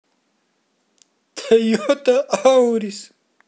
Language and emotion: Russian, sad